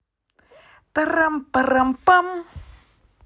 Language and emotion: Russian, positive